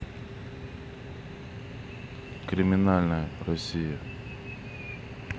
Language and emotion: Russian, neutral